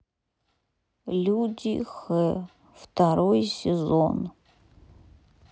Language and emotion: Russian, sad